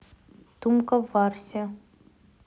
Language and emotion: Russian, neutral